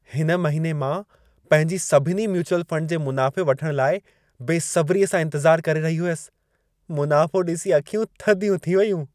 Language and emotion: Sindhi, happy